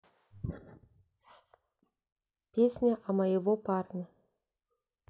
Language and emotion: Russian, sad